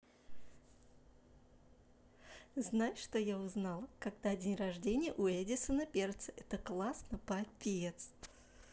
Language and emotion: Russian, positive